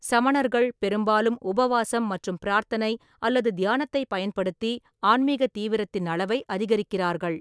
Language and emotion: Tamil, neutral